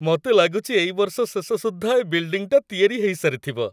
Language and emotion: Odia, happy